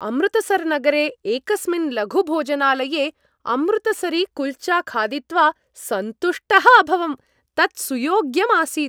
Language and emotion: Sanskrit, happy